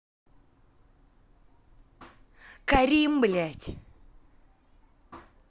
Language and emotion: Russian, angry